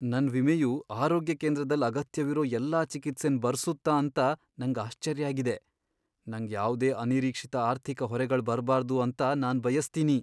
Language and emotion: Kannada, fearful